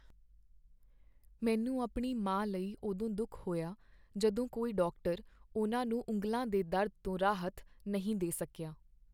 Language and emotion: Punjabi, sad